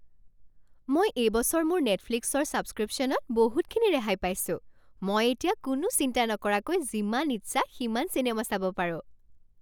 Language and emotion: Assamese, happy